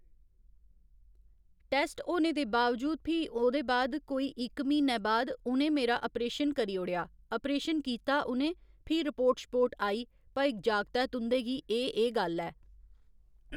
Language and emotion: Dogri, neutral